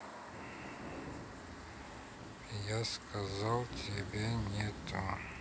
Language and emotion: Russian, neutral